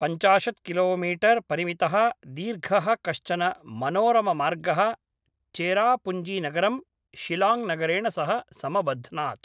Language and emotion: Sanskrit, neutral